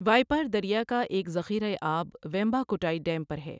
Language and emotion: Urdu, neutral